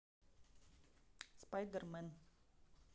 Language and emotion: Russian, neutral